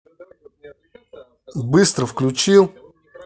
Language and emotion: Russian, angry